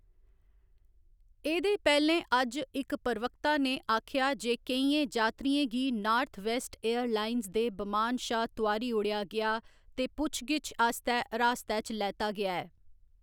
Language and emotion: Dogri, neutral